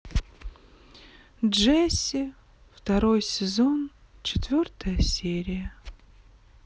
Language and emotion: Russian, sad